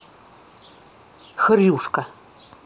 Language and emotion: Russian, angry